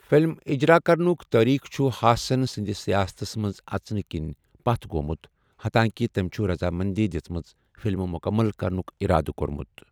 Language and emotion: Kashmiri, neutral